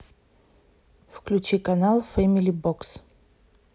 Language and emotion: Russian, neutral